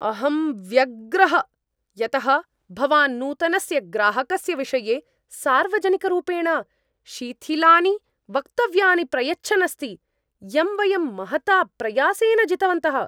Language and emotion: Sanskrit, angry